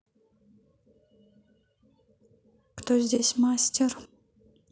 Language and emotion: Russian, neutral